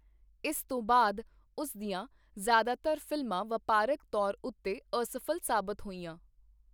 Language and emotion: Punjabi, neutral